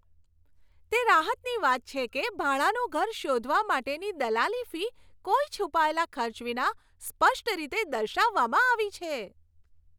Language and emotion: Gujarati, happy